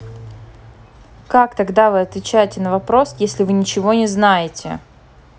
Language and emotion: Russian, angry